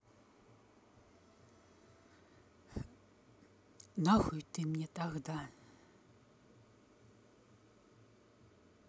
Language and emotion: Russian, neutral